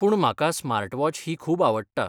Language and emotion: Goan Konkani, neutral